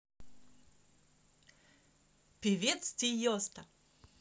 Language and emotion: Russian, positive